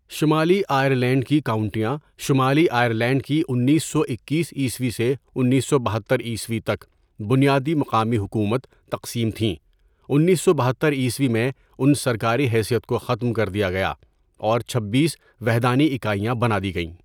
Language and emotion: Urdu, neutral